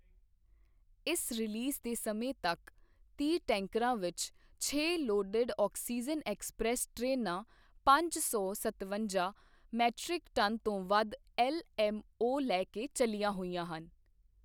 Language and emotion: Punjabi, neutral